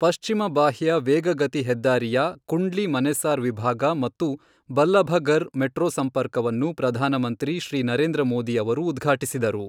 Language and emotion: Kannada, neutral